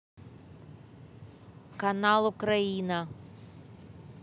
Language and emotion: Russian, neutral